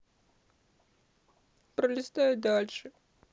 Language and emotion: Russian, sad